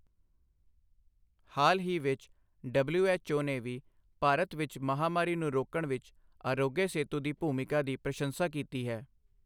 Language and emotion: Punjabi, neutral